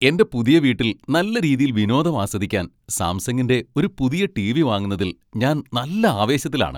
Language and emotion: Malayalam, happy